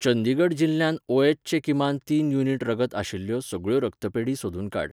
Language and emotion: Goan Konkani, neutral